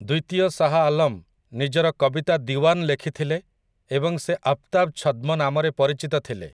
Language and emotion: Odia, neutral